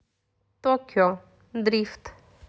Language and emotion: Russian, neutral